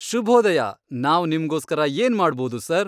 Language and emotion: Kannada, happy